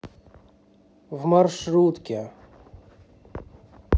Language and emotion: Russian, neutral